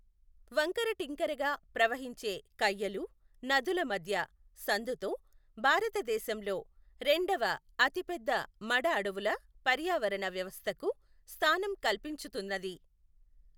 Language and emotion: Telugu, neutral